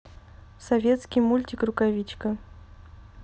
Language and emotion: Russian, neutral